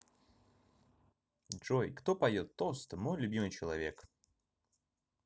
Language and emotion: Russian, positive